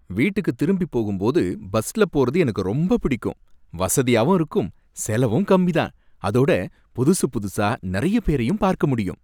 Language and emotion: Tamil, happy